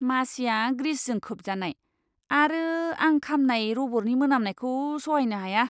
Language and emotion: Bodo, disgusted